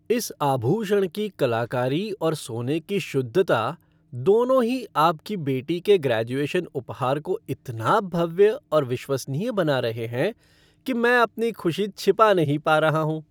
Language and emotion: Hindi, happy